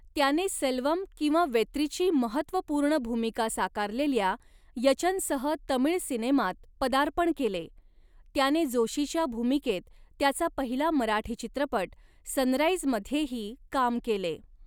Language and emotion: Marathi, neutral